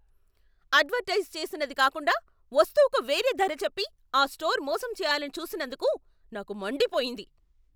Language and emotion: Telugu, angry